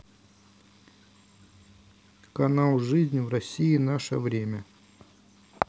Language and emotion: Russian, neutral